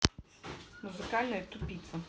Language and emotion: Russian, angry